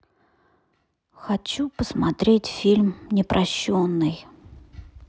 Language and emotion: Russian, sad